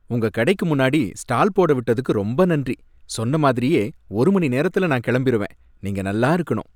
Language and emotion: Tamil, happy